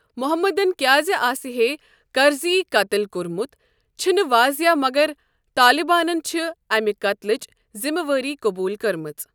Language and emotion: Kashmiri, neutral